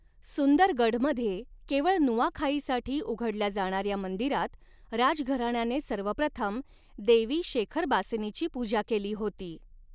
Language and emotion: Marathi, neutral